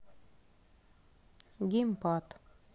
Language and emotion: Russian, neutral